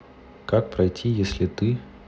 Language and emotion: Russian, neutral